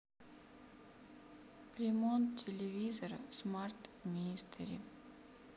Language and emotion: Russian, sad